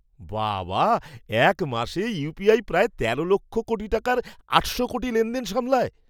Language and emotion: Bengali, surprised